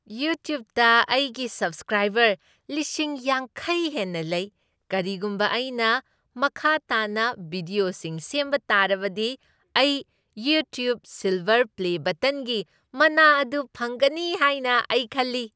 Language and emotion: Manipuri, happy